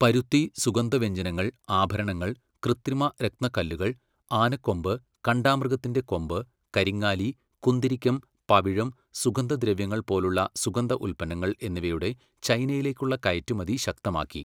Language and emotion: Malayalam, neutral